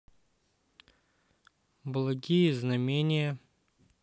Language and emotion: Russian, neutral